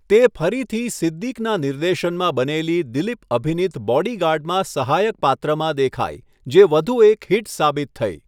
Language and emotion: Gujarati, neutral